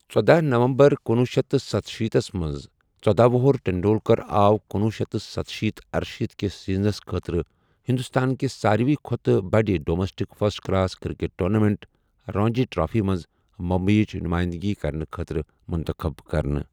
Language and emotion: Kashmiri, neutral